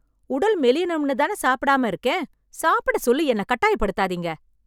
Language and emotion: Tamil, angry